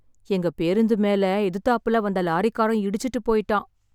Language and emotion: Tamil, sad